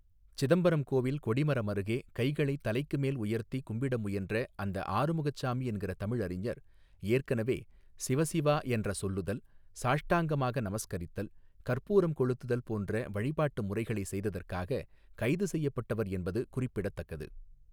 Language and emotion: Tamil, neutral